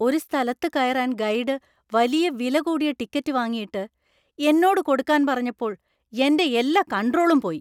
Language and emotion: Malayalam, angry